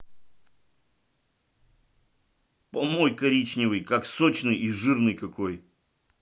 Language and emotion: Russian, angry